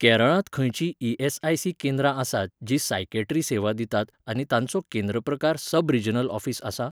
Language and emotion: Goan Konkani, neutral